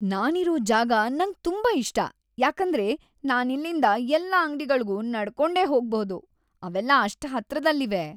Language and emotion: Kannada, happy